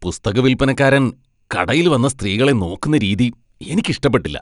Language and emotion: Malayalam, disgusted